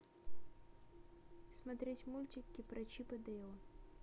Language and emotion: Russian, neutral